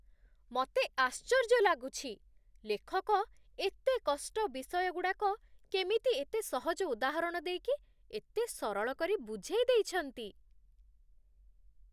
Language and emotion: Odia, surprised